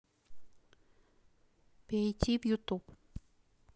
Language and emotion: Russian, neutral